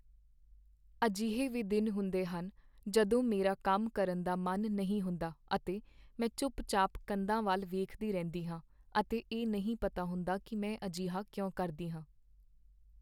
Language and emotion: Punjabi, sad